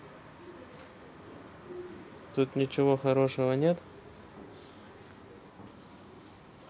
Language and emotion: Russian, neutral